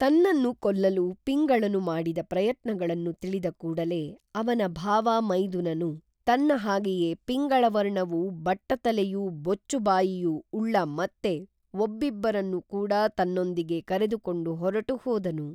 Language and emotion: Kannada, neutral